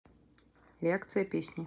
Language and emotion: Russian, neutral